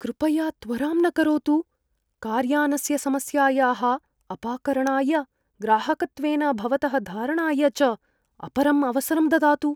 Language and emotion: Sanskrit, fearful